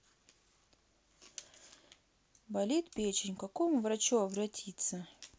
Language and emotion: Russian, sad